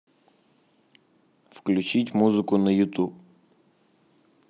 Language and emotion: Russian, neutral